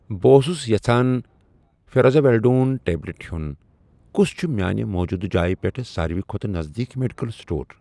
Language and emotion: Kashmiri, neutral